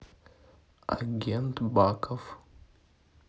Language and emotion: Russian, neutral